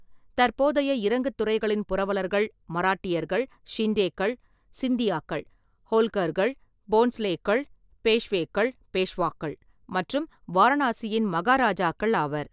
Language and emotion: Tamil, neutral